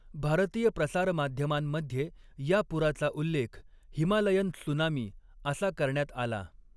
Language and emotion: Marathi, neutral